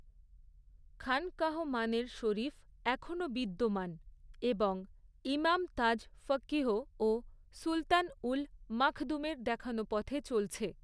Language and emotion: Bengali, neutral